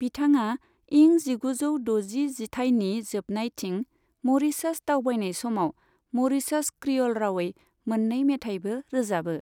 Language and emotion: Bodo, neutral